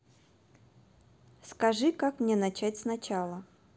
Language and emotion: Russian, neutral